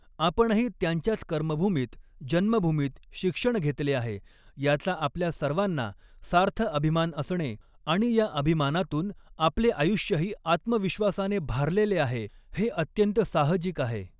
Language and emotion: Marathi, neutral